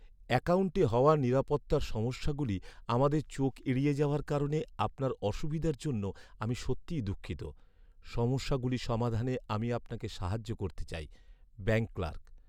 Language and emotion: Bengali, sad